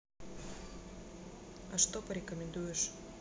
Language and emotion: Russian, neutral